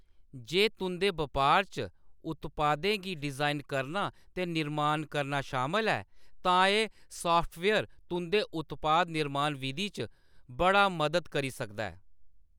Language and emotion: Dogri, neutral